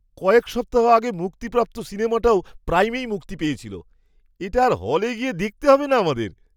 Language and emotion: Bengali, surprised